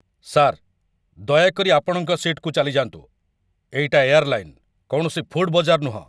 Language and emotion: Odia, angry